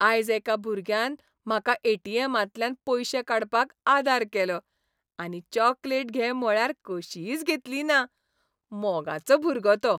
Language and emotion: Goan Konkani, happy